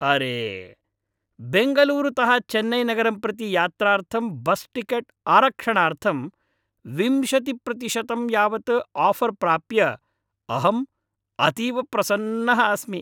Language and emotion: Sanskrit, happy